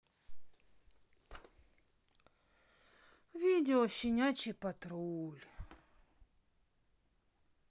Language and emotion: Russian, sad